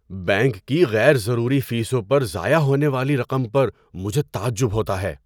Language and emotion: Urdu, surprised